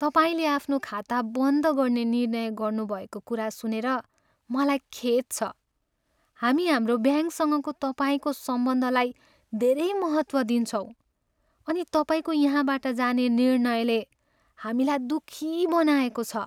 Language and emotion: Nepali, sad